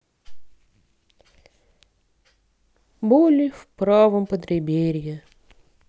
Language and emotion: Russian, sad